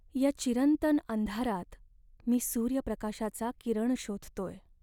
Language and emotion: Marathi, sad